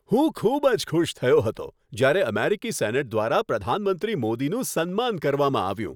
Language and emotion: Gujarati, happy